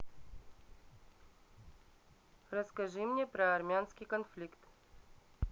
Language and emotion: Russian, neutral